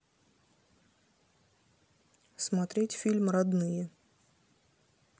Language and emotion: Russian, neutral